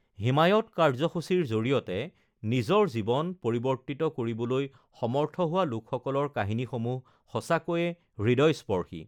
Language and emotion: Assamese, neutral